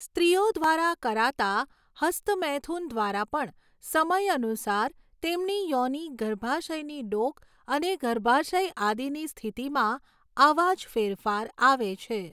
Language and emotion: Gujarati, neutral